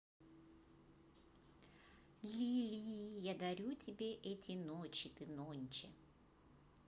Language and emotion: Russian, positive